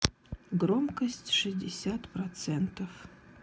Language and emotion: Russian, sad